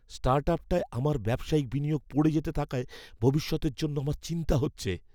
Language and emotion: Bengali, fearful